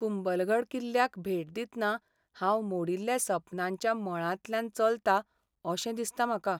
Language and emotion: Goan Konkani, sad